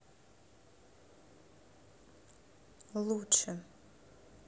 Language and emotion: Russian, neutral